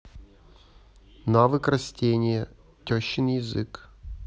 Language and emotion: Russian, neutral